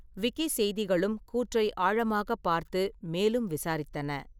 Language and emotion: Tamil, neutral